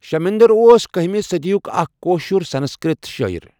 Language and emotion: Kashmiri, neutral